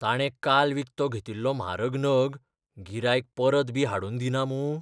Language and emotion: Goan Konkani, fearful